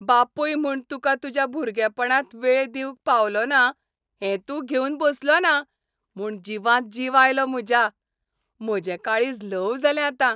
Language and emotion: Goan Konkani, happy